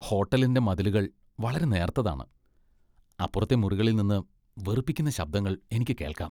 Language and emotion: Malayalam, disgusted